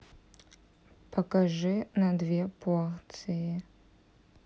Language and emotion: Russian, neutral